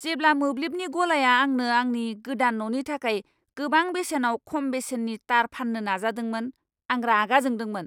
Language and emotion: Bodo, angry